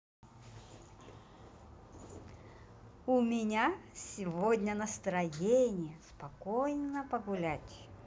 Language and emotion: Russian, positive